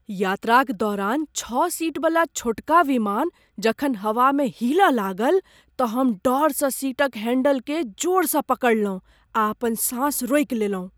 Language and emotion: Maithili, fearful